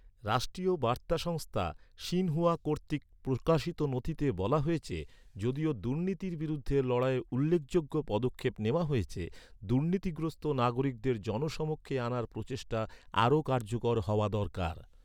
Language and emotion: Bengali, neutral